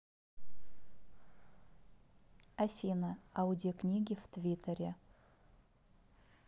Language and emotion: Russian, neutral